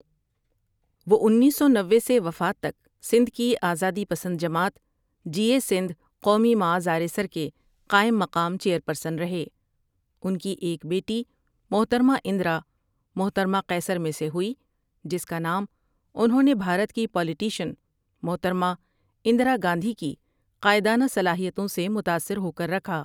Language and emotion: Urdu, neutral